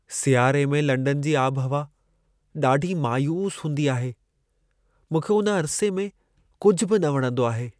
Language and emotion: Sindhi, sad